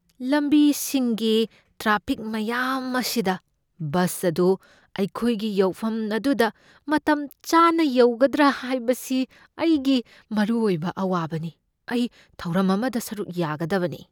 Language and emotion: Manipuri, fearful